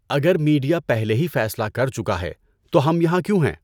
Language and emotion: Urdu, neutral